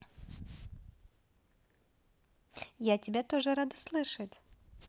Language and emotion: Russian, positive